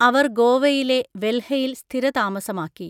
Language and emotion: Malayalam, neutral